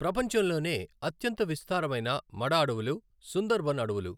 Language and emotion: Telugu, neutral